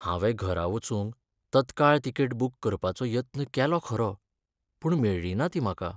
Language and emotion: Goan Konkani, sad